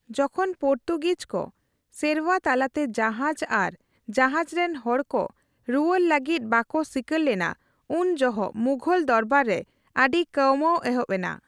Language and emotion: Santali, neutral